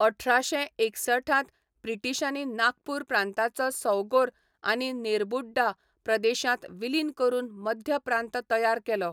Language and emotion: Goan Konkani, neutral